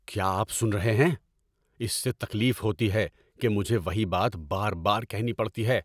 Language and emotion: Urdu, angry